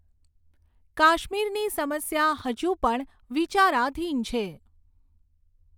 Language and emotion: Gujarati, neutral